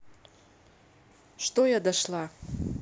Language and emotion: Russian, neutral